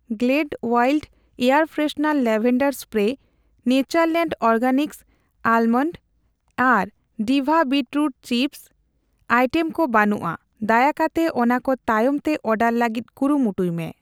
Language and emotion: Santali, neutral